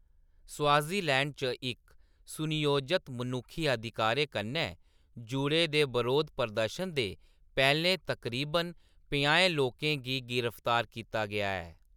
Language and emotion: Dogri, neutral